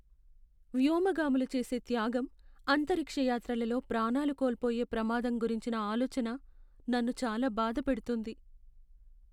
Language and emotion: Telugu, sad